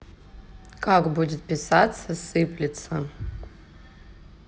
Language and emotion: Russian, neutral